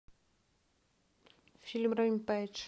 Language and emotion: Russian, neutral